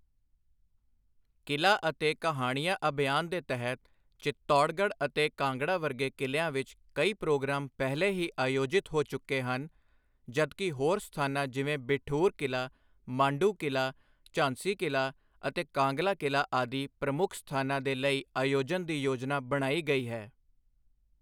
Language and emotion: Punjabi, neutral